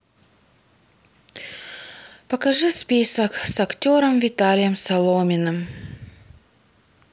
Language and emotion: Russian, sad